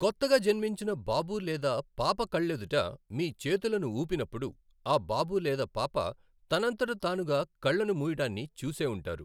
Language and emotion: Telugu, neutral